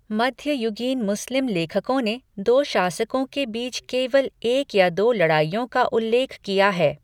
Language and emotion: Hindi, neutral